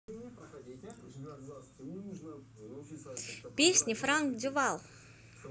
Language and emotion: Russian, positive